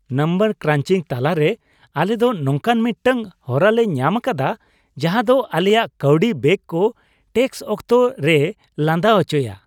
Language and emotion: Santali, happy